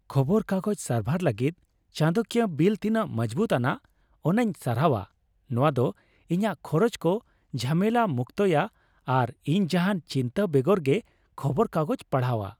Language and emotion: Santali, happy